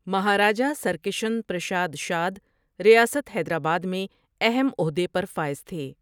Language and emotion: Urdu, neutral